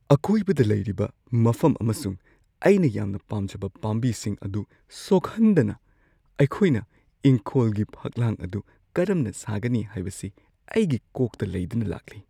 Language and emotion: Manipuri, fearful